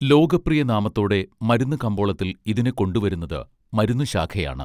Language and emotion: Malayalam, neutral